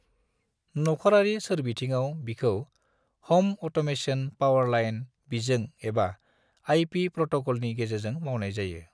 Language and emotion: Bodo, neutral